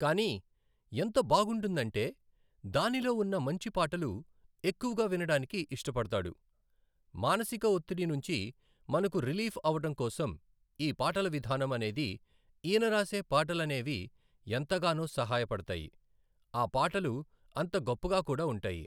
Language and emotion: Telugu, neutral